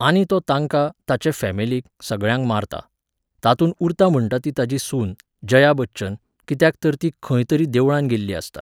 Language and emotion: Goan Konkani, neutral